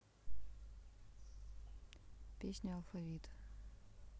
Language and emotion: Russian, sad